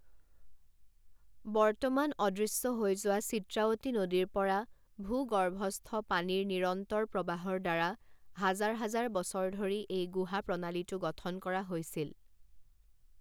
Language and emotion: Assamese, neutral